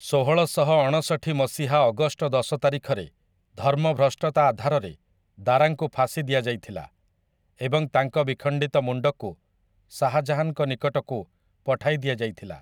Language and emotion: Odia, neutral